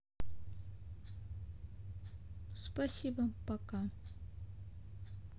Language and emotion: Russian, sad